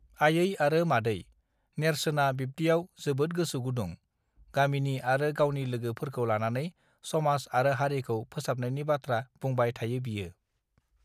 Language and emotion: Bodo, neutral